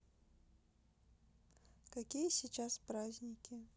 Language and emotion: Russian, neutral